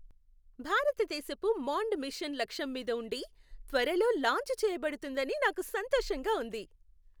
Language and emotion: Telugu, happy